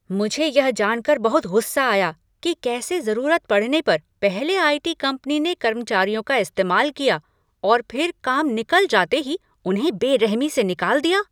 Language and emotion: Hindi, angry